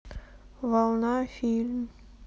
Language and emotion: Russian, sad